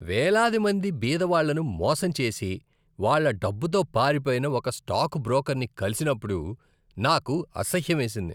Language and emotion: Telugu, disgusted